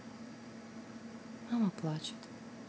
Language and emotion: Russian, sad